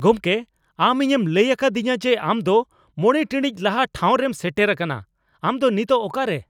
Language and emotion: Santali, angry